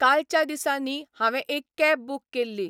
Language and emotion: Goan Konkani, neutral